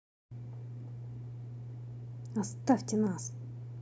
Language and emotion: Russian, angry